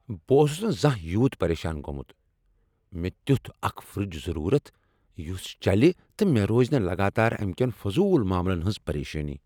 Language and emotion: Kashmiri, angry